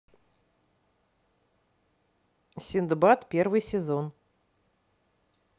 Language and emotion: Russian, neutral